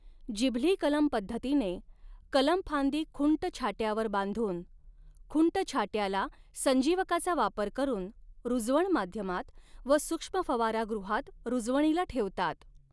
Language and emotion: Marathi, neutral